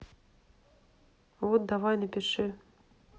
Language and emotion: Russian, neutral